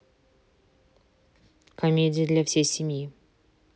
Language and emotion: Russian, neutral